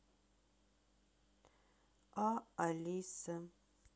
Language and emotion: Russian, sad